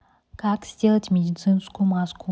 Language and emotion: Russian, neutral